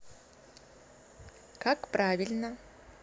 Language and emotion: Russian, neutral